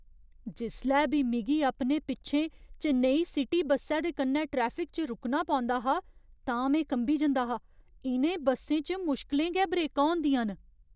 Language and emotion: Dogri, fearful